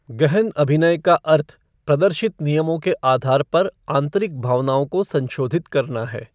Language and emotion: Hindi, neutral